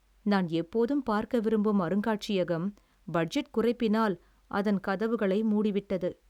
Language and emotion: Tamil, sad